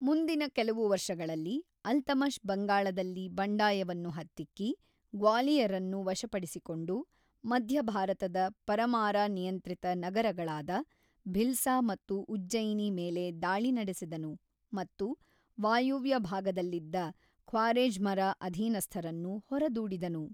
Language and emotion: Kannada, neutral